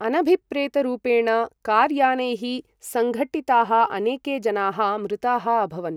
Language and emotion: Sanskrit, neutral